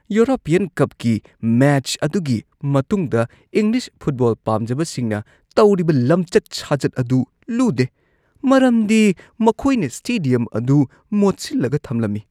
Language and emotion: Manipuri, disgusted